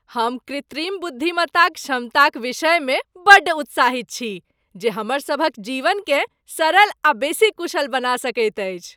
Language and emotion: Maithili, happy